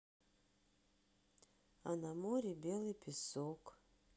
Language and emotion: Russian, sad